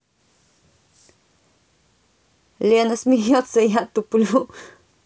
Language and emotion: Russian, positive